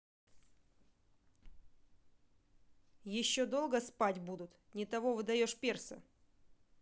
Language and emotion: Russian, angry